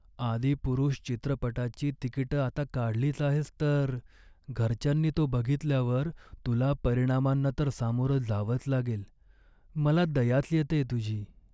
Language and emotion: Marathi, sad